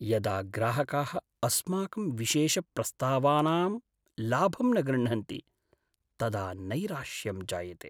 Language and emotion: Sanskrit, sad